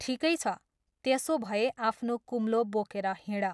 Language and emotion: Nepali, neutral